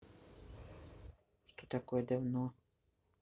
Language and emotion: Russian, neutral